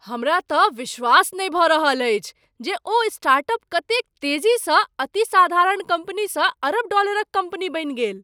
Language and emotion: Maithili, surprised